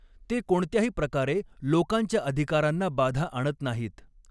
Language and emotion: Marathi, neutral